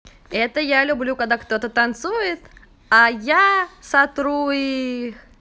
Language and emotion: Russian, positive